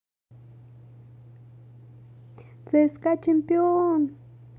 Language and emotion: Russian, positive